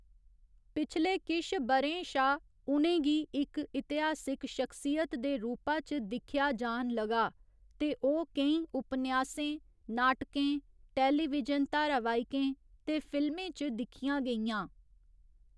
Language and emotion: Dogri, neutral